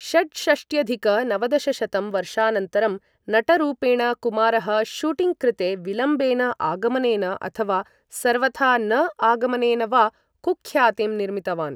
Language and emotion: Sanskrit, neutral